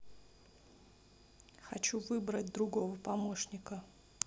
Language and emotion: Russian, neutral